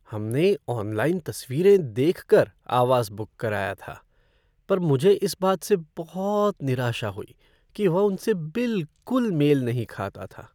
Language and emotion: Hindi, sad